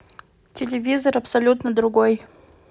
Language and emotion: Russian, neutral